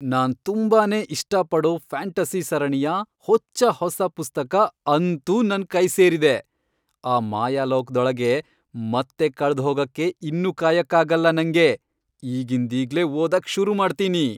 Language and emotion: Kannada, happy